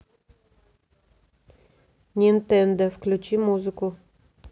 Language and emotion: Russian, neutral